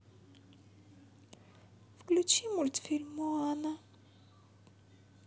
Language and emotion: Russian, sad